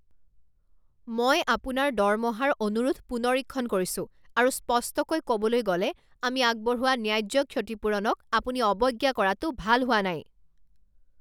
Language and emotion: Assamese, angry